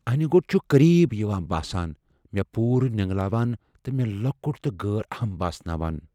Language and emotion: Kashmiri, fearful